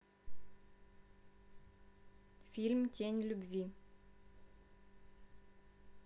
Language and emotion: Russian, neutral